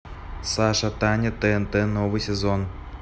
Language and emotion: Russian, neutral